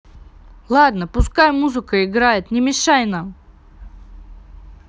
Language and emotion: Russian, angry